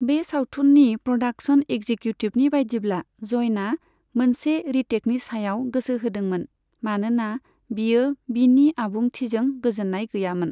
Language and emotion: Bodo, neutral